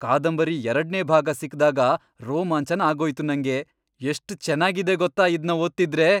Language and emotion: Kannada, happy